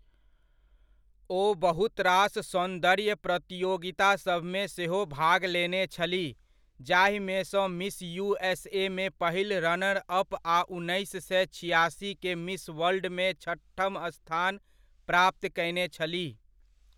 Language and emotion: Maithili, neutral